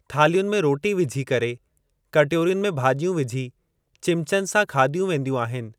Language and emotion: Sindhi, neutral